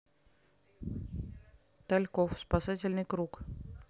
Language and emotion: Russian, neutral